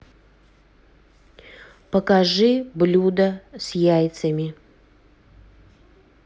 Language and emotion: Russian, neutral